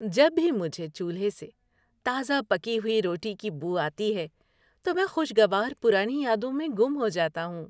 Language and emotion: Urdu, happy